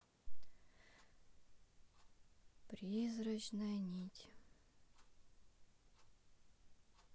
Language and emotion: Russian, neutral